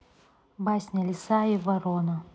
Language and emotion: Russian, neutral